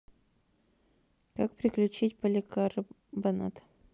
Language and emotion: Russian, neutral